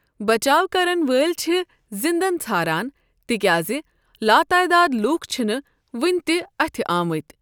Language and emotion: Kashmiri, neutral